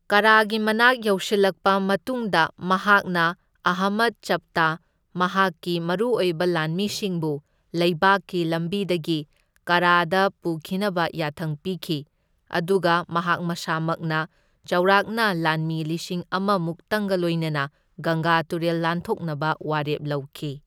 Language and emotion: Manipuri, neutral